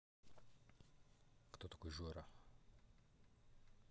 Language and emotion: Russian, neutral